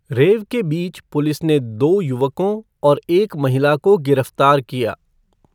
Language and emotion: Hindi, neutral